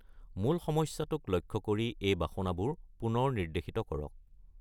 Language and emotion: Assamese, neutral